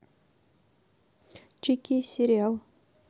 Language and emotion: Russian, neutral